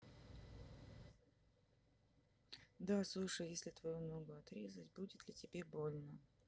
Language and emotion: Russian, neutral